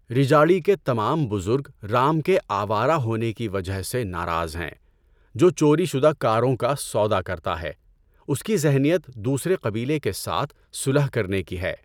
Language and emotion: Urdu, neutral